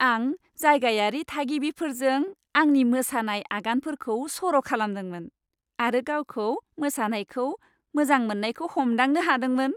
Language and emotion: Bodo, happy